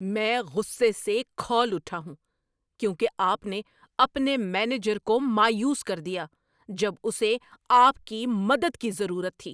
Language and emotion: Urdu, angry